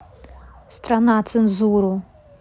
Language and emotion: Russian, neutral